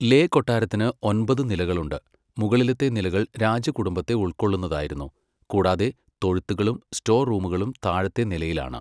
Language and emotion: Malayalam, neutral